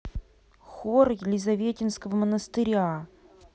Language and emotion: Russian, neutral